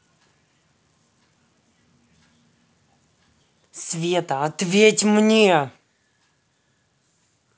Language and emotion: Russian, angry